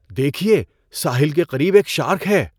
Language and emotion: Urdu, surprised